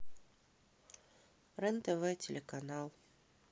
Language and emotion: Russian, neutral